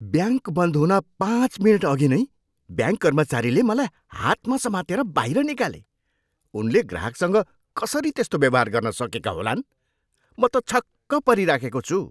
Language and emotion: Nepali, surprised